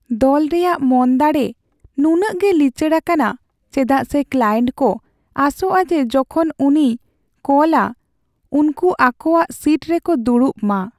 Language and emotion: Santali, sad